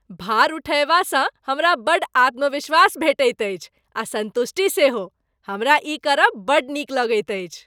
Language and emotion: Maithili, happy